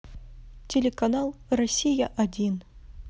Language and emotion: Russian, neutral